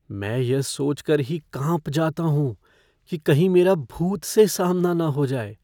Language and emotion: Hindi, fearful